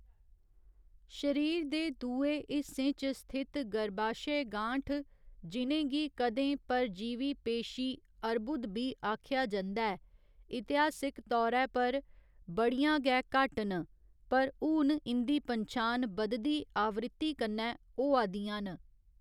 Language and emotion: Dogri, neutral